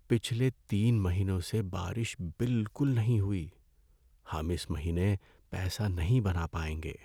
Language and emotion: Urdu, sad